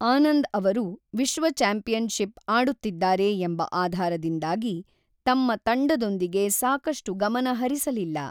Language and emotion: Kannada, neutral